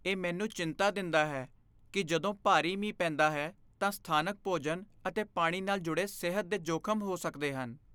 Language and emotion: Punjabi, fearful